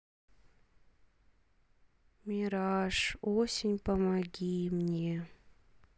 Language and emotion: Russian, sad